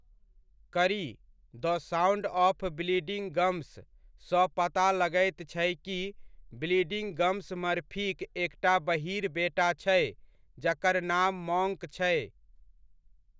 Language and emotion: Maithili, neutral